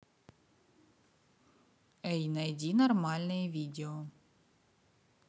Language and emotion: Russian, neutral